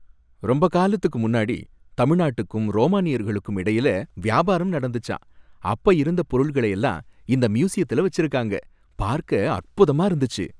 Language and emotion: Tamil, happy